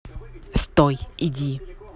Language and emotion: Russian, neutral